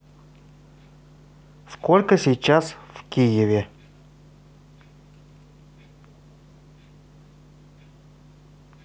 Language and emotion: Russian, neutral